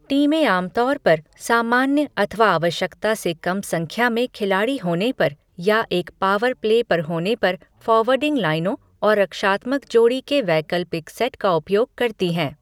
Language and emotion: Hindi, neutral